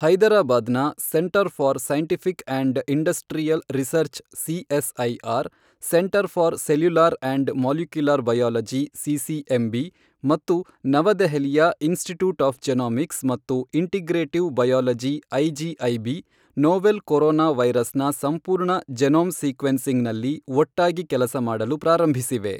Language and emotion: Kannada, neutral